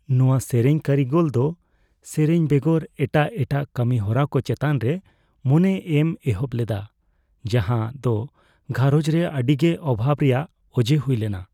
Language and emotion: Santali, fearful